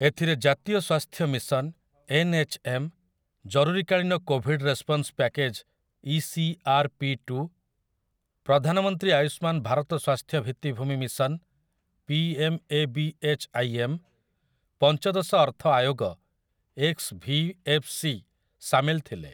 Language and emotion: Odia, neutral